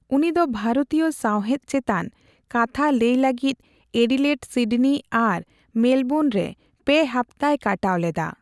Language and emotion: Santali, neutral